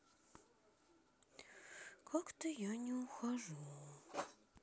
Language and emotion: Russian, sad